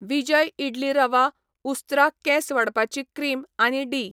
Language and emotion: Goan Konkani, neutral